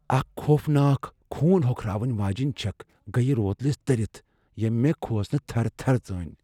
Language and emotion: Kashmiri, fearful